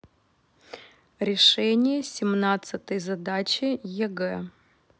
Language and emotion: Russian, neutral